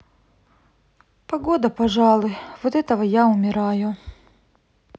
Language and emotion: Russian, sad